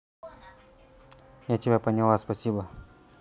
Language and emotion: Russian, neutral